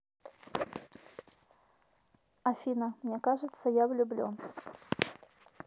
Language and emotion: Russian, neutral